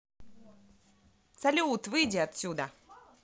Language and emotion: Russian, positive